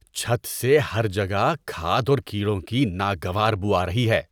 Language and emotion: Urdu, disgusted